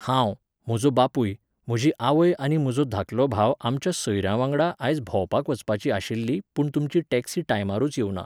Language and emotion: Goan Konkani, neutral